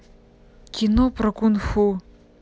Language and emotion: Russian, neutral